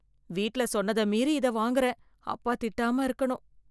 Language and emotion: Tamil, fearful